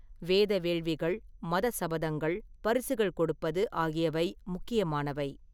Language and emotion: Tamil, neutral